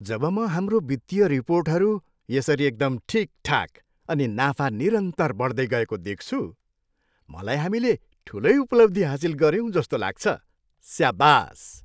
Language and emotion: Nepali, happy